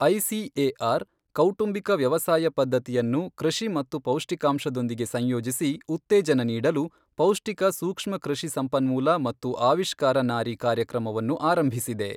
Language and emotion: Kannada, neutral